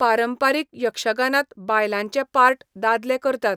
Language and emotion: Goan Konkani, neutral